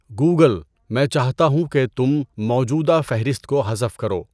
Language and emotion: Urdu, neutral